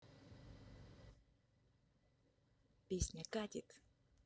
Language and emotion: Russian, neutral